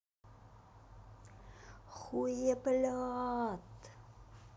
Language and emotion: Russian, angry